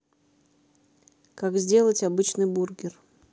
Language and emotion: Russian, neutral